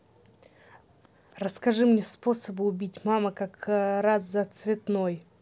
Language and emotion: Russian, neutral